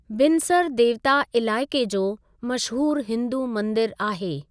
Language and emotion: Sindhi, neutral